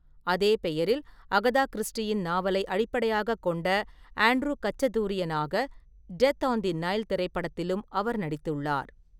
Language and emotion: Tamil, neutral